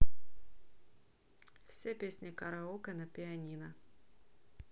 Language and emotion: Russian, neutral